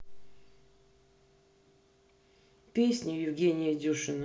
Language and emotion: Russian, neutral